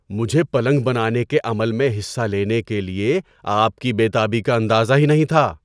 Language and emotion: Urdu, surprised